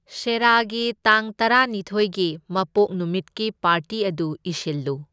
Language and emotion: Manipuri, neutral